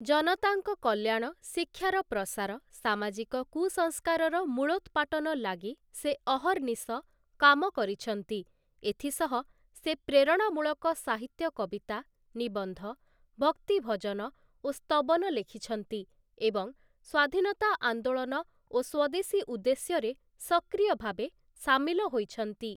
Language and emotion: Odia, neutral